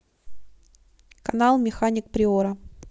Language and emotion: Russian, neutral